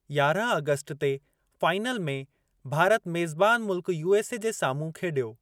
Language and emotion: Sindhi, neutral